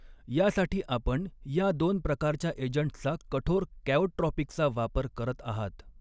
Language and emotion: Marathi, neutral